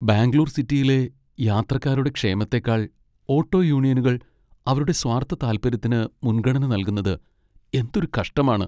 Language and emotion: Malayalam, sad